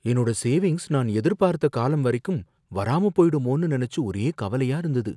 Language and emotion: Tamil, fearful